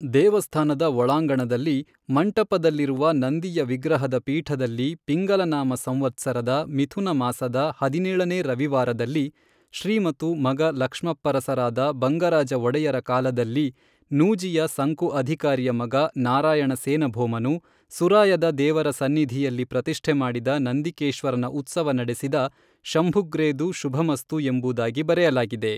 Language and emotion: Kannada, neutral